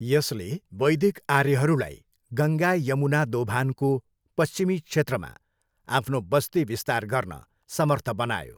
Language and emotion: Nepali, neutral